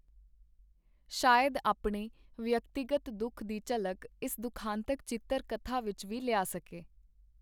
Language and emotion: Punjabi, neutral